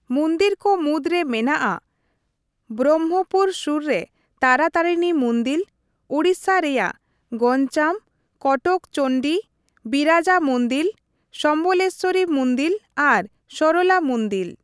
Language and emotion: Santali, neutral